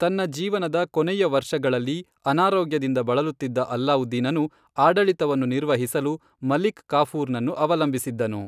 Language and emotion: Kannada, neutral